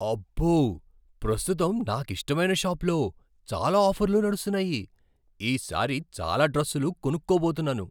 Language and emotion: Telugu, surprised